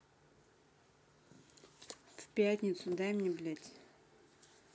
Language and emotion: Russian, angry